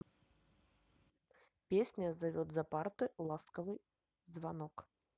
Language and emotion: Russian, neutral